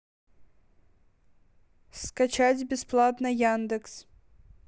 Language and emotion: Russian, neutral